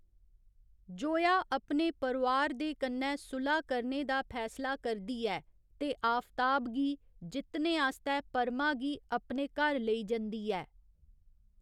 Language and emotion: Dogri, neutral